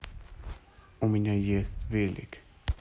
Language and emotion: Russian, neutral